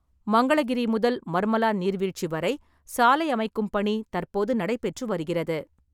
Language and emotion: Tamil, neutral